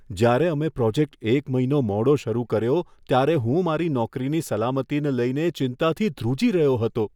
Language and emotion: Gujarati, fearful